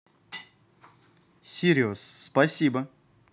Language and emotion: Russian, positive